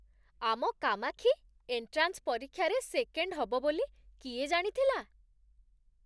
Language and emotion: Odia, surprised